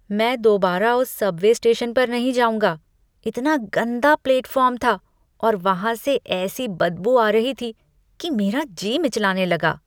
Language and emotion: Hindi, disgusted